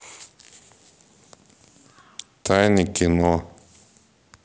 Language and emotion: Russian, neutral